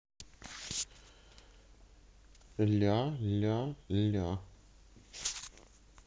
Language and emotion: Russian, neutral